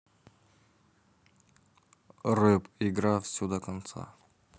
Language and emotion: Russian, neutral